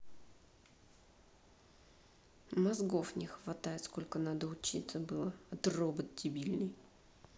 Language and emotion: Russian, angry